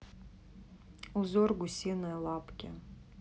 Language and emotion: Russian, neutral